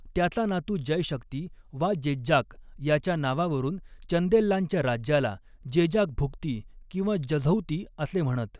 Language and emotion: Marathi, neutral